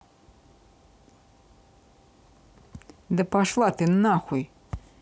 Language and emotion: Russian, angry